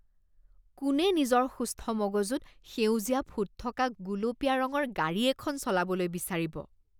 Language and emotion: Assamese, disgusted